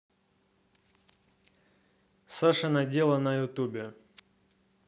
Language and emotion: Russian, neutral